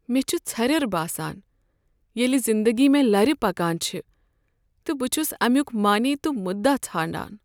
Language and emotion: Kashmiri, sad